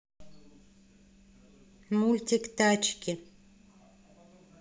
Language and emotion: Russian, neutral